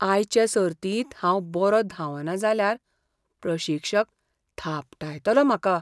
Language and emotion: Goan Konkani, fearful